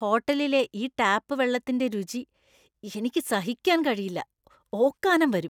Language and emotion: Malayalam, disgusted